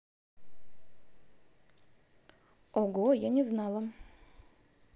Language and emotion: Russian, neutral